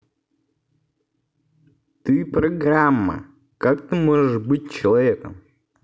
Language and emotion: Russian, neutral